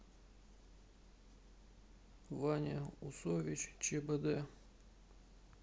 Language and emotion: Russian, sad